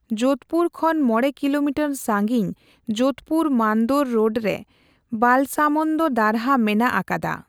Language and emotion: Santali, neutral